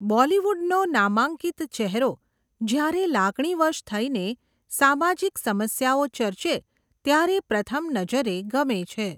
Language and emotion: Gujarati, neutral